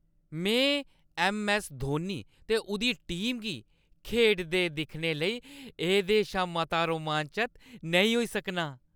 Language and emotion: Dogri, happy